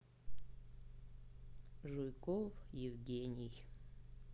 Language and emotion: Russian, sad